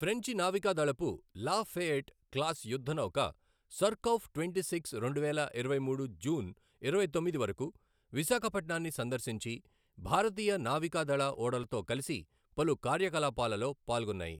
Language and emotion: Telugu, neutral